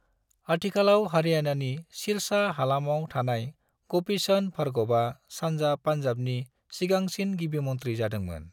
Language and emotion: Bodo, neutral